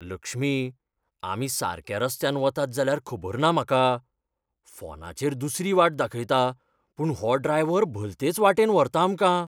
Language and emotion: Goan Konkani, fearful